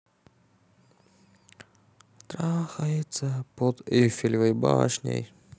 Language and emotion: Russian, neutral